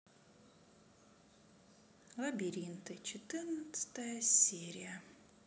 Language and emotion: Russian, sad